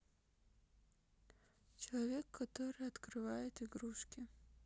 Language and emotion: Russian, sad